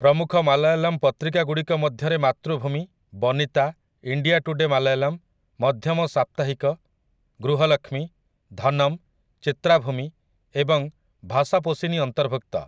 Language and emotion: Odia, neutral